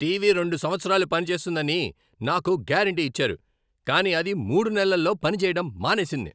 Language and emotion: Telugu, angry